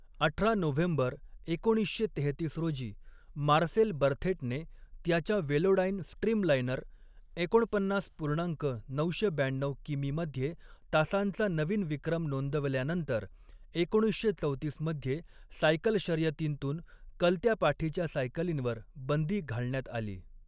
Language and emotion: Marathi, neutral